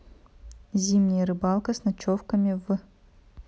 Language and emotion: Russian, neutral